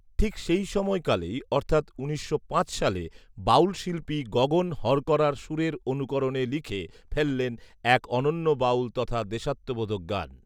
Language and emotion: Bengali, neutral